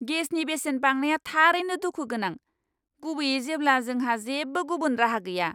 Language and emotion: Bodo, angry